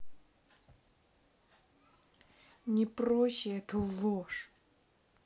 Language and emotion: Russian, angry